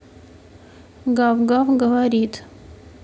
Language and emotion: Russian, neutral